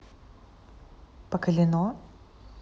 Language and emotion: Russian, neutral